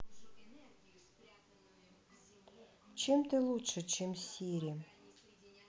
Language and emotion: Russian, sad